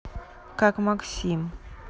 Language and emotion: Russian, neutral